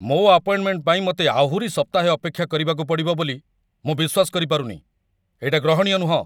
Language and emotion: Odia, angry